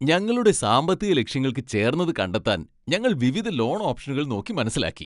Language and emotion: Malayalam, happy